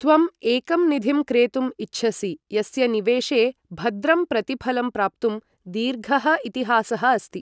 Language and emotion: Sanskrit, neutral